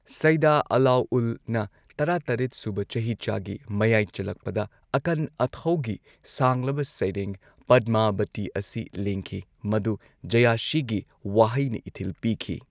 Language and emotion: Manipuri, neutral